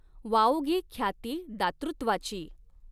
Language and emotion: Marathi, neutral